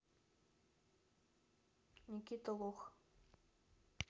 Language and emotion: Russian, neutral